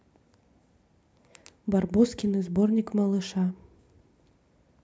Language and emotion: Russian, neutral